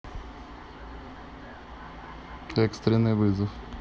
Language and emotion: Russian, neutral